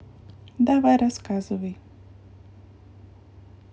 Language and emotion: Russian, neutral